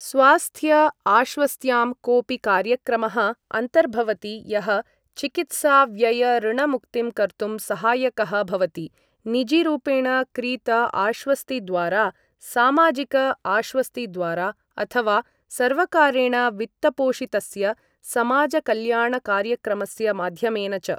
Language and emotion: Sanskrit, neutral